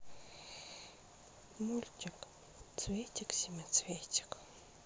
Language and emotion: Russian, sad